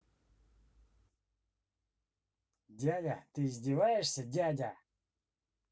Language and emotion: Russian, angry